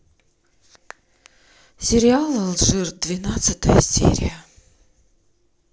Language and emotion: Russian, sad